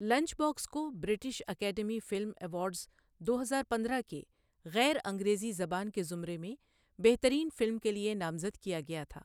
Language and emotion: Urdu, neutral